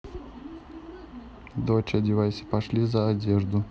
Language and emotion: Russian, neutral